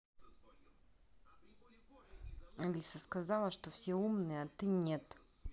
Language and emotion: Russian, angry